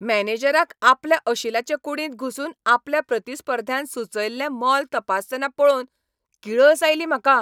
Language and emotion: Goan Konkani, angry